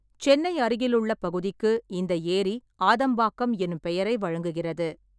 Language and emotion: Tamil, neutral